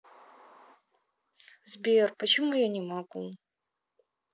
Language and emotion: Russian, sad